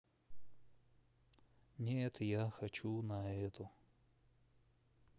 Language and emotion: Russian, sad